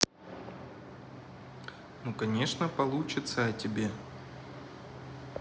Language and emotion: Russian, neutral